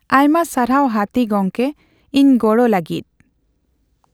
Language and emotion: Santali, neutral